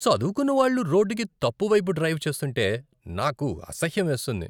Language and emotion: Telugu, disgusted